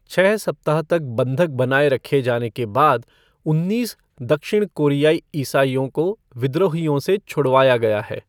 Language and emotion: Hindi, neutral